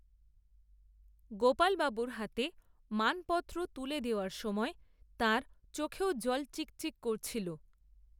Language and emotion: Bengali, neutral